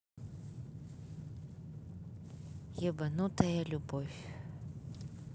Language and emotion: Russian, neutral